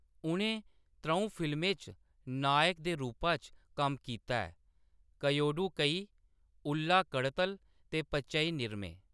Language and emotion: Dogri, neutral